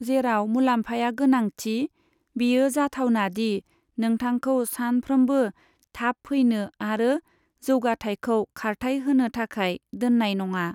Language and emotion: Bodo, neutral